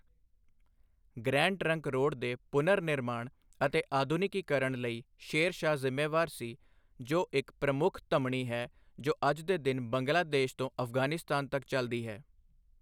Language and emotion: Punjabi, neutral